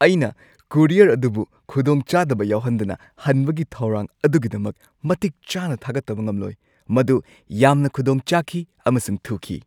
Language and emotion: Manipuri, happy